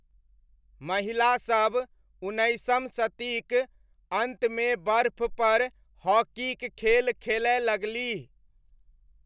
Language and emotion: Maithili, neutral